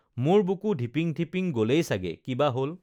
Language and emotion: Assamese, neutral